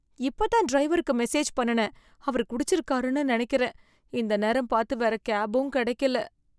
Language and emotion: Tamil, fearful